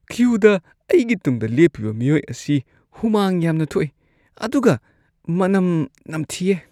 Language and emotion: Manipuri, disgusted